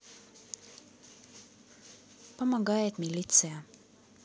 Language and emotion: Russian, neutral